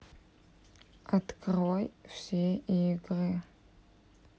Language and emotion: Russian, neutral